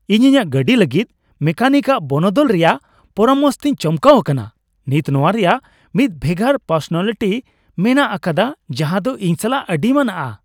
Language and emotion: Santali, happy